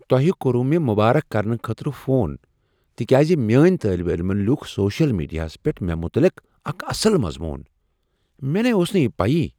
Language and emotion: Kashmiri, surprised